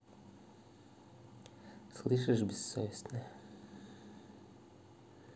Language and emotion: Russian, angry